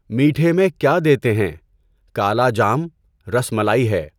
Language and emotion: Urdu, neutral